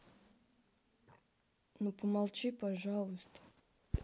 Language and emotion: Russian, neutral